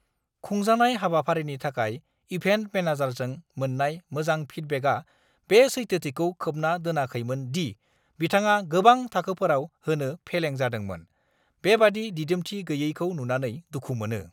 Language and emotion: Bodo, angry